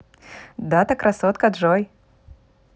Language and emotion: Russian, positive